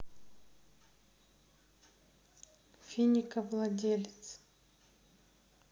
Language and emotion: Russian, sad